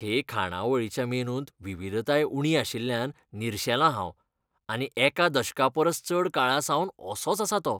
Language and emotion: Goan Konkani, disgusted